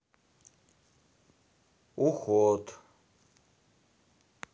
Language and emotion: Russian, neutral